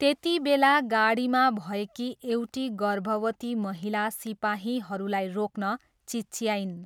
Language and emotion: Nepali, neutral